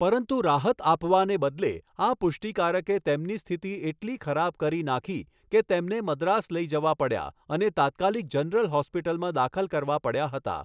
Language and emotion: Gujarati, neutral